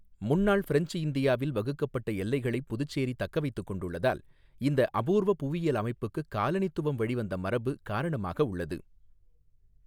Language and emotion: Tamil, neutral